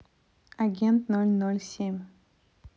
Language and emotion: Russian, neutral